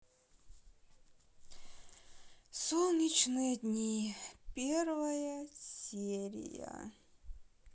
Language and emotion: Russian, sad